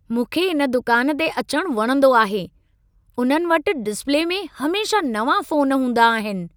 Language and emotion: Sindhi, happy